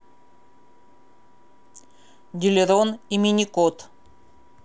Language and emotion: Russian, neutral